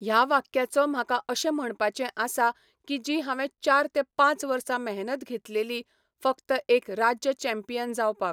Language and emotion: Goan Konkani, neutral